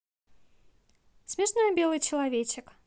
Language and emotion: Russian, positive